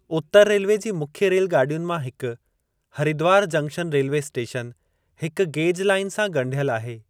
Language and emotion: Sindhi, neutral